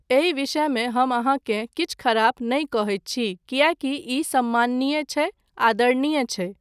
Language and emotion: Maithili, neutral